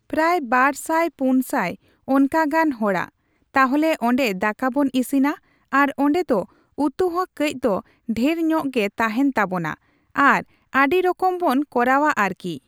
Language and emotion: Santali, neutral